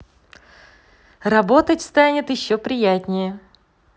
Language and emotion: Russian, positive